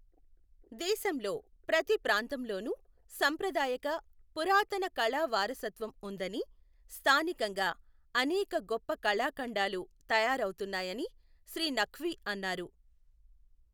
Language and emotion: Telugu, neutral